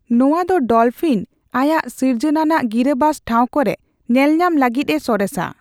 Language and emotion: Santali, neutral